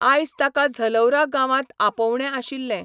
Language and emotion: Goan Konkani, neutral